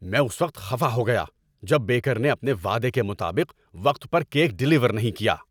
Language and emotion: Urdu, angry